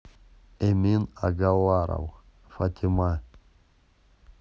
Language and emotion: Russian, neutral